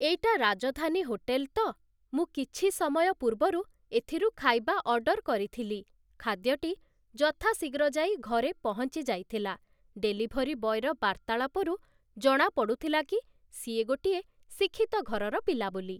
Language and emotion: Odia, neutral